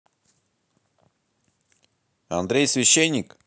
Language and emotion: Russian, neutral